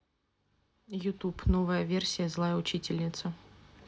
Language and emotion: Russian, neutral